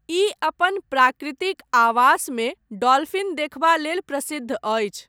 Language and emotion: Maithili, neutral